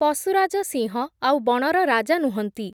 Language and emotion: Odia, neutral